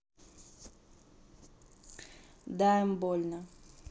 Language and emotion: Russian, neutral